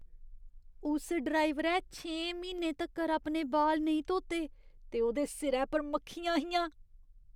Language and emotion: Dogri, disgusted